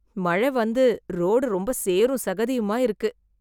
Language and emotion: Tamil, disgusted